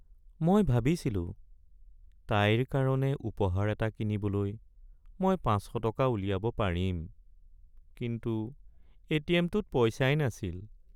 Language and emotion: Assamese, sad